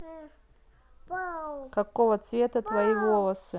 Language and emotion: Russian, neutral